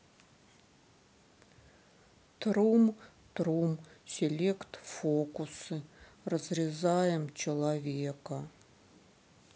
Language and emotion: Russian, sad